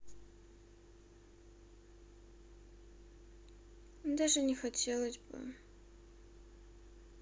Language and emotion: Russian, sad